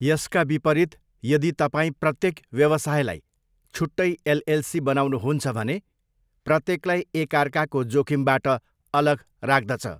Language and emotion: Nepali, neutral